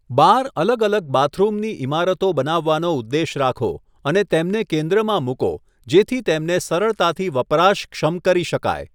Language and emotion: Gujarati, neutral